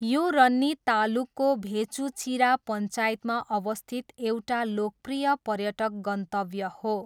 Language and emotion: Nepali, neutral